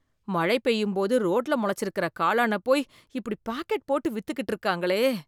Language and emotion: Tamil, disgusted